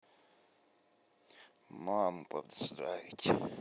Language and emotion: Russian, sad